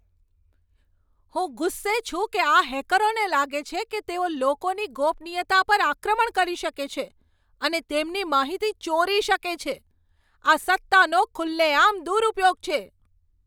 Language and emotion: Gujarati, angry